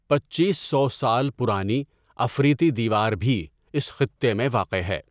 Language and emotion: Urdu, neutral